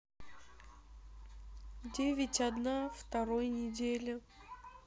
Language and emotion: Russian, sad